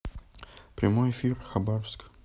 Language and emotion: Russian, neutral